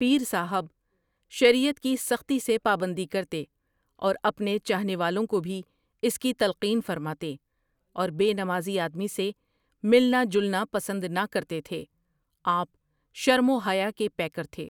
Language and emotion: Urdu, neutral